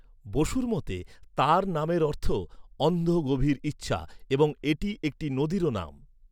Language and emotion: Bengali, neutral